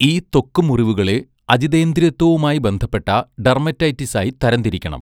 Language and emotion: Malayalam, neutral